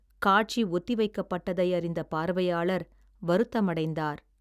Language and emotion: Tamil, sad